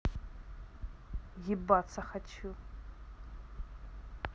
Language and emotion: Russian, angry